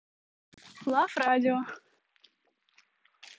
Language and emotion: Russian, neutral